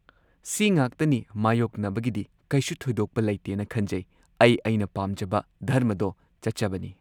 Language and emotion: Manipuri, neutral